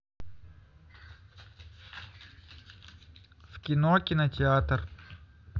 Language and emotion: Russian, neutral